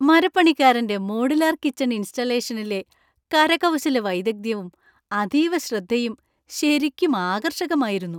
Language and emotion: Malayalam, happy